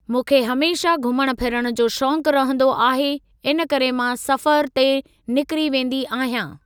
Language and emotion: Sindhi, neutral